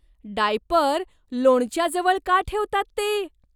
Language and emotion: Marathi, disgusted